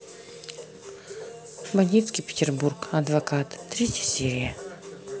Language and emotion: Russian, neutral